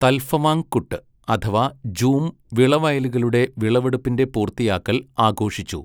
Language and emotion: Malayalam, neutral